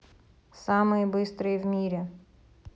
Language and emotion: Russian, neutral